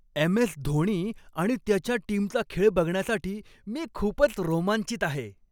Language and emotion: Marathi, happy